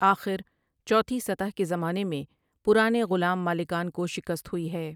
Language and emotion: Urdu, neutral